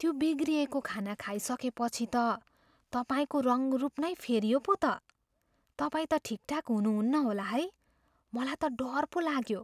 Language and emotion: Nepali, fearful